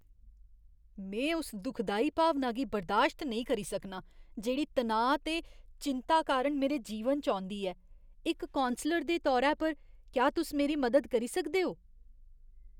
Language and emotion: Dogri, disgusted